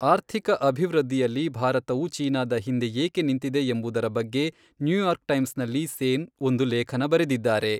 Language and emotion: Kannada, neutral